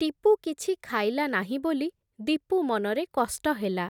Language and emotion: Odia, neutral